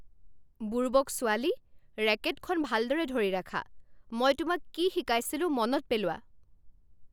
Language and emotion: Assamese, angry